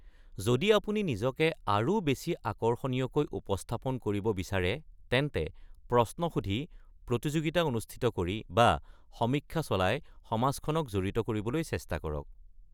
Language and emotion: Assamese, neutral